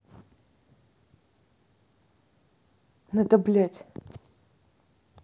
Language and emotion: Russian, angry